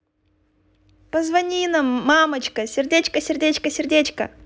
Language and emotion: Russian, positive